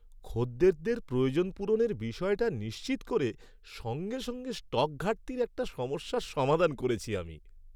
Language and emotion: Bengali, happy